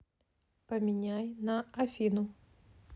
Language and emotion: Russian, neutral